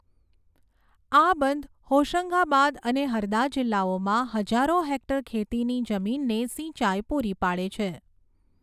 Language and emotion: Gujarati, neutral